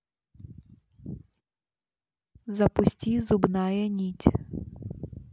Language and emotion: Russian, neutral